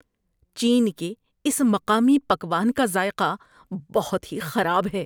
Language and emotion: Urdu, disgusted